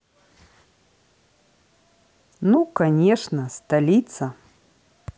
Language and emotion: Russian, neutral